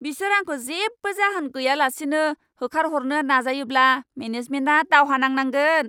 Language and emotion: Bodo, angry